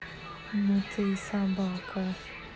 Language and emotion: Russian, neutral